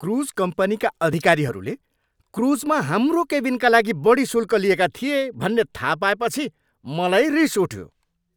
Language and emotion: Nepali, angry